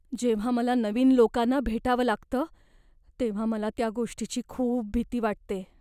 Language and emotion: Marathi, fearful